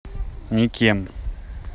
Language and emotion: Russian, neutral